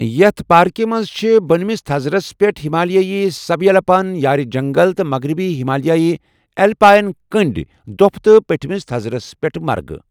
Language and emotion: Kashmiri, neutral